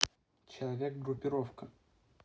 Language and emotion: Russian, neutral